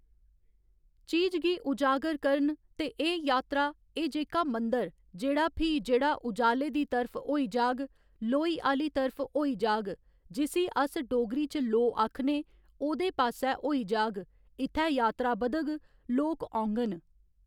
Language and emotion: Dogri, neutral